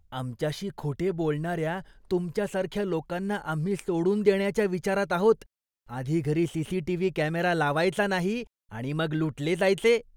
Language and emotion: Marathi, disgusted